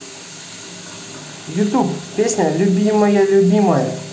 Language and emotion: Russian, neutral